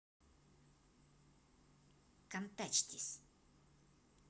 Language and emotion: Russian, angry